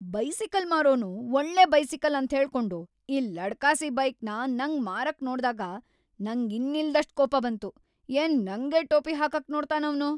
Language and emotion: Kannada, angry